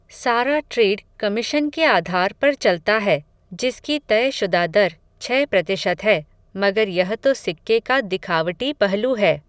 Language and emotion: Hindi, neutral